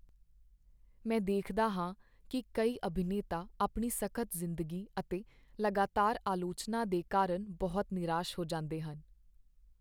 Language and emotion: Punjabi, sad